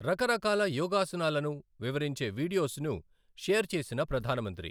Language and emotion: Telugu, neutral